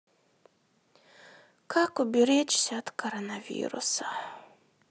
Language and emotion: Russian, sad